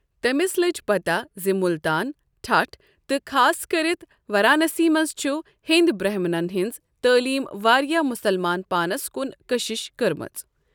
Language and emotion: Kashmiri, neutral